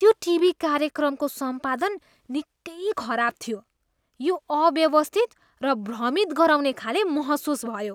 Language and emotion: Nepali, disgusted